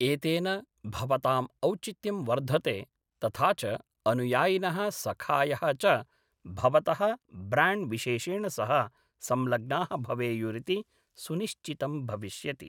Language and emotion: Sanskrit, neutral